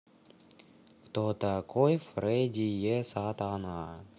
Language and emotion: Russian, neutral